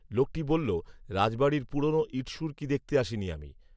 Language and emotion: Bengali, neutral